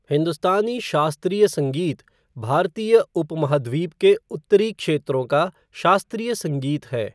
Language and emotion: Hindi, neutral